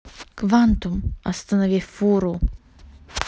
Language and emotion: Russian, neutral